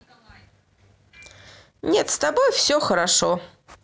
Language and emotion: Russian, neutral